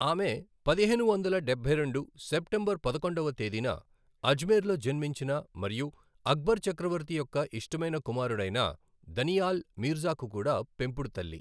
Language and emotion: Telugu, neutral